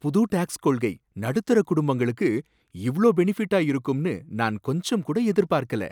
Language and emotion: Tamil, surprised